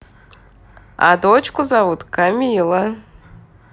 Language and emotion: Russian, positive